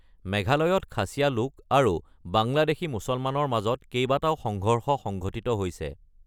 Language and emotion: Assamese, neutral